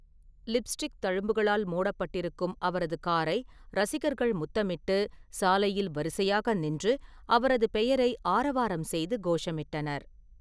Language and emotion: Tamil, neutral